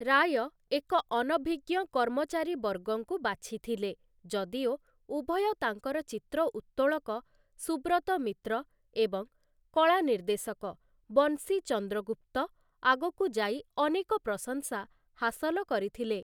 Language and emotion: Odia, neutral